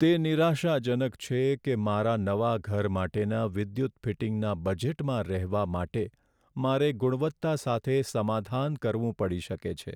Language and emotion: Gujarati, sad